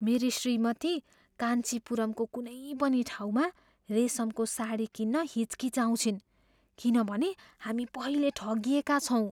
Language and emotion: Nepali, fearful